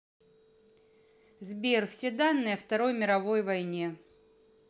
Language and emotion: Russian, neutral